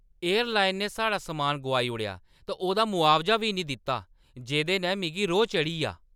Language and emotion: Dogri, angry